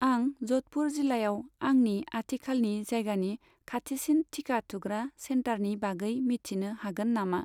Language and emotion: Bodo, neutral